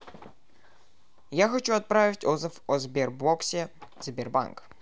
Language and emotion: Russian, neutral